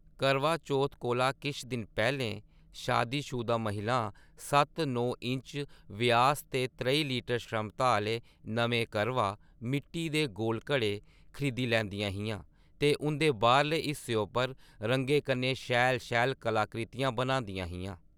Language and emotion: Dogri, neutral